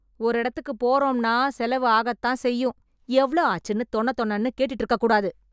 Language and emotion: Tamil, angry